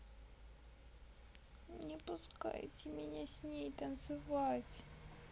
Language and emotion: Russian, sad